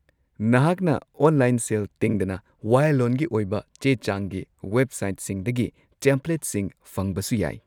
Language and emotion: Manipuri, neutral